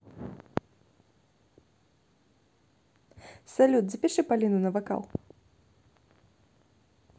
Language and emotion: Russian, neutral